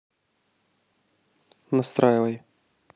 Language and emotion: Russian, neutral